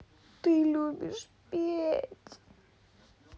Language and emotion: Russian, sad